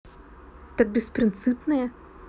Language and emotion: Russian, neutral